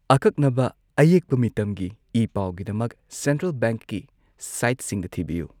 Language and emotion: Manipuri, neutral